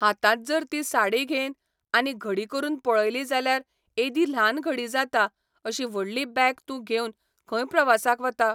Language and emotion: Goan Konkani, neutral